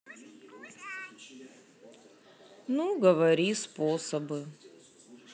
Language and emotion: Russian, sad